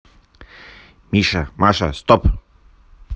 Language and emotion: Russian, neutral